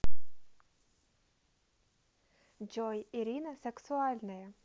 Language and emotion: Russian, neutral